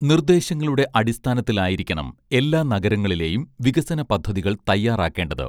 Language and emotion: Malayalam, neutral